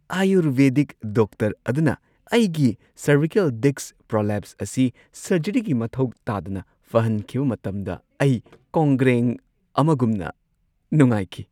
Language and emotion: Manipuri, happy